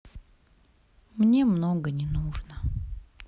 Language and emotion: Russian, sad